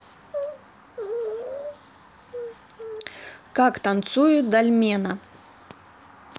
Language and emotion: Russian, neutral